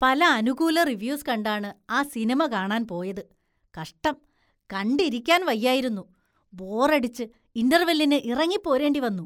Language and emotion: Malayalam, disgusted